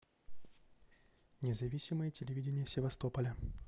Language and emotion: Russian, neutral